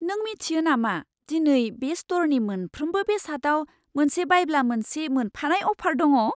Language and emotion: Bodo, surprised